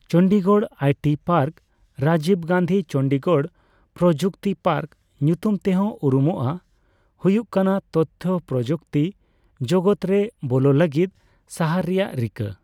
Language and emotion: Santali, neutral